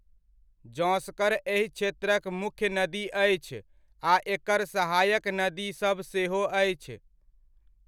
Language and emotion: Maithili, neutral